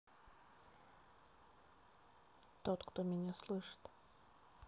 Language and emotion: Russian, sad